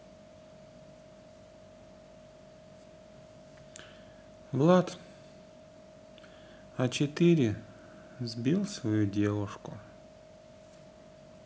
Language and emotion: Russian, neutral